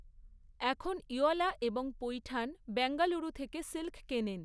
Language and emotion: Bengali, neutral